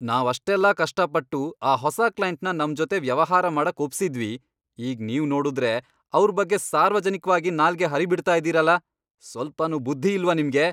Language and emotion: Kannada, angry